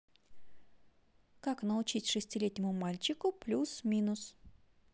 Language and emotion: Russian, positive